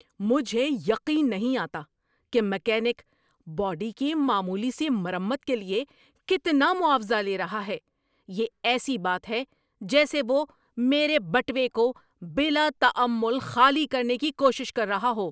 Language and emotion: Urdu, angry